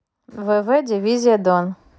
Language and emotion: Russian, neutral